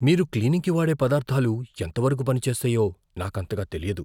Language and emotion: Telugu, fearful